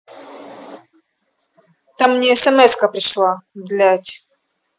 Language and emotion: Russian, angry